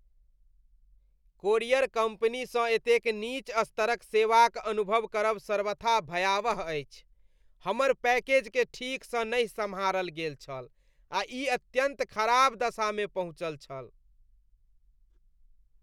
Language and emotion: Maithili, disgusted